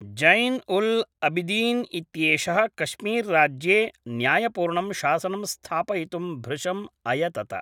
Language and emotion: Sanskrit, neutral